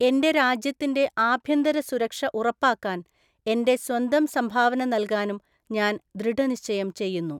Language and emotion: Malayalam, neutral